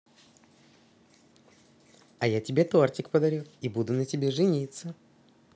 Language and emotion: Russian, positive